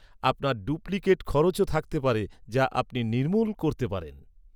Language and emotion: Bengali, neutral